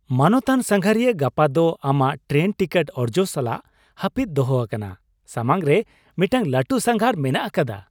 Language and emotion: Santali, happy